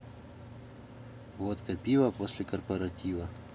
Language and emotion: Russian, neutral